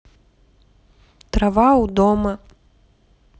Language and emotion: Russian, neutral